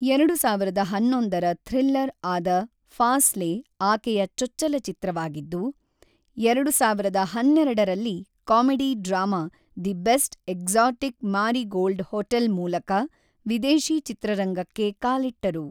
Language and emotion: Kannada, neutral